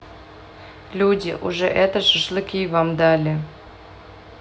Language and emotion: Russian, neutral